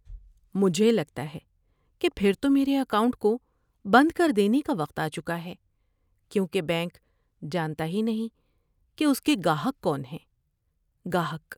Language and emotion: Urdu, sad